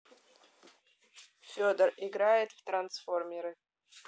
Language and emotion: Russian, neutral